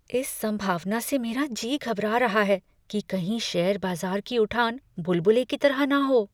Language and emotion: Hindi, fearful